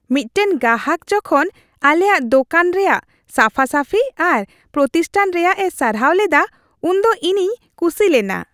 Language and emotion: Santali, happy